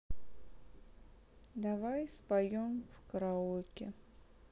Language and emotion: Russian, sad